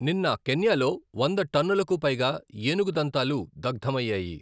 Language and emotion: Telugu, neutral